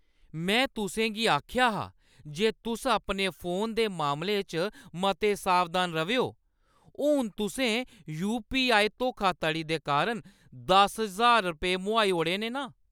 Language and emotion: Dogri, angry